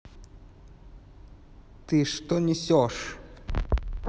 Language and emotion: Russian, angry